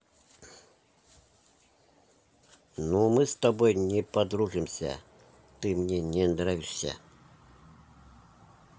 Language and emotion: Russian, neutral